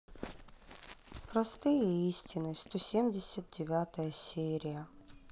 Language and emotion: Russian, sad